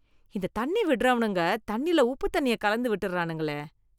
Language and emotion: Tamil, disgusted